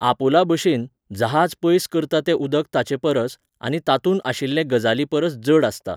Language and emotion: Goan Konkani, neutral